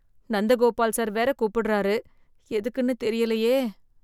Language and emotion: Tamil, fearful